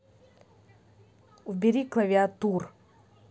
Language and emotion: Russian, angry